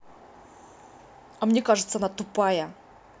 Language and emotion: Russian, angry